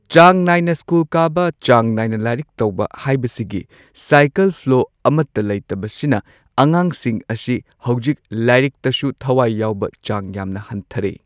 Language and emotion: Manipuri, neutral